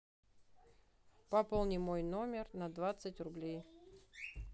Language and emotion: Russian, neutral